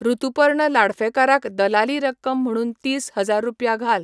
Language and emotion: Goan Konkani, neutral